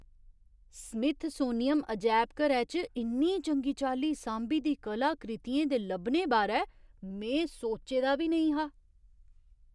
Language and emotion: Dogri, surprised